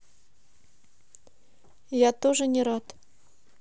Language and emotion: Russian, neutral